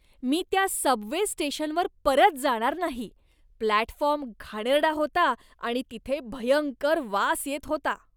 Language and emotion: Marathi, disgusted